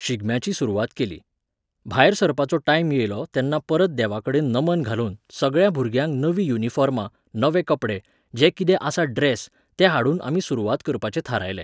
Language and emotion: Goan Konkani, neutral